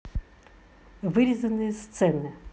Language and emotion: Russian, neutral